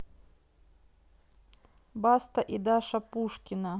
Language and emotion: Russian, neutral